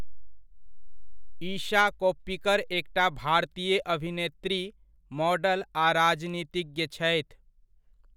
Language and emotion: Maithili, neutral